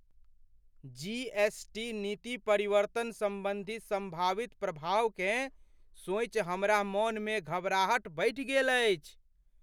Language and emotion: Maithili, fearful